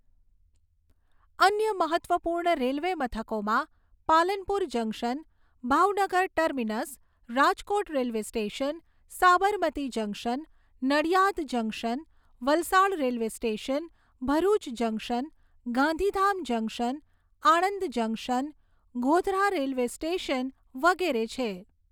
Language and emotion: Gujarati, neutral